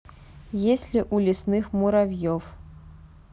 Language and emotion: Russian, neutral